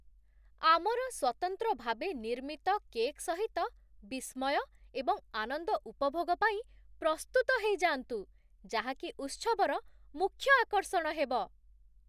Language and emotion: Odia, surprised